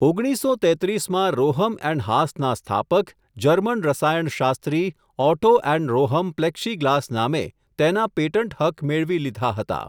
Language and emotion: Gujarati, neutral